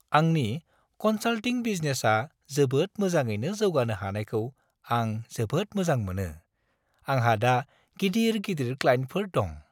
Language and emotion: Bodo, happy